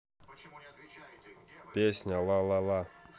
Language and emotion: Russian, neutral